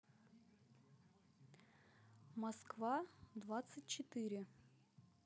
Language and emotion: Russian, neutral